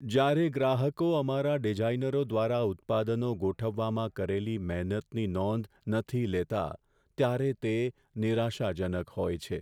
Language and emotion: Gujarati, sad